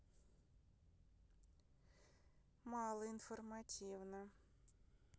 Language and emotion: Russian, neutral